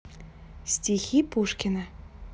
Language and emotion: Russian, neutral